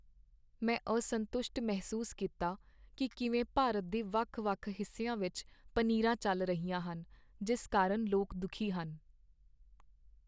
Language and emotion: Punjabi, sad